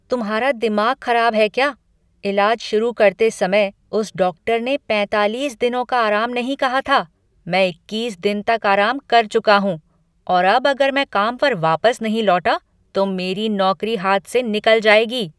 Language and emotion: Hindi, angry